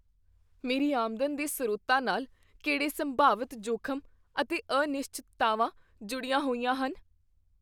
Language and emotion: Punjabi, fearful